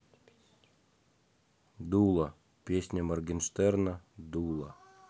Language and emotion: Russian, neutral